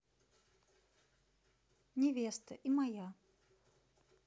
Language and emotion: Russian, neutral